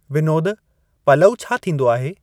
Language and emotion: Sindhi, neutral